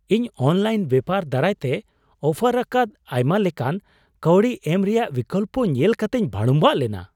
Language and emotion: Santali, surprised